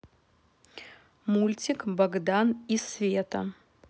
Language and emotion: Russian, neutral